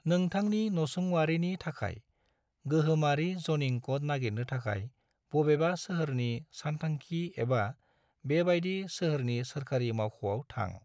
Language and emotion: Bodo, neutral